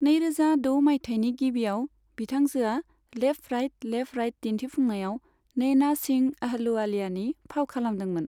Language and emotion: Bodo, neutral